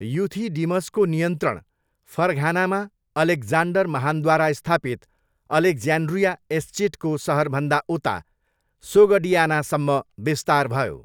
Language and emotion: Nepali, neutral